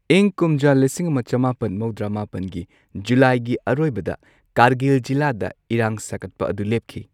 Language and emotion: Manipuri, neutral